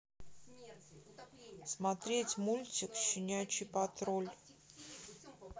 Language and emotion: Russian, neutral